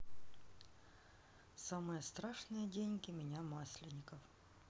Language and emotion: Russian, neutral